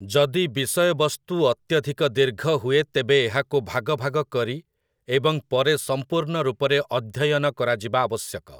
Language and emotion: Odia, neutral